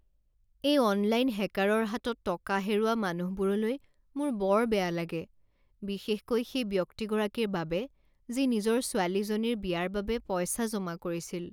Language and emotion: Assamese, sad